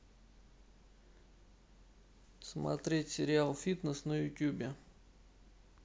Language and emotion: Russian, neutral